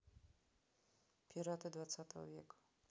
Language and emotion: Russian, neutral